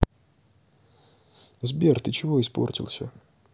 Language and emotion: Russian, neutral